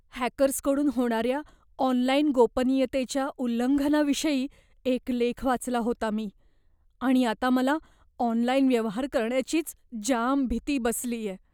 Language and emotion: Marathi, fearful